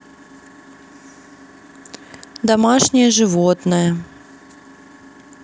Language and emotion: Russian, neutral